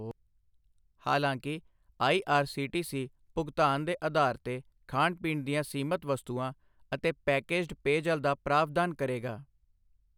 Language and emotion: Punjabi, neutral